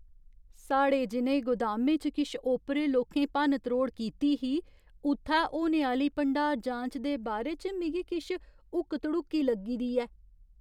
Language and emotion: Dogri, fearful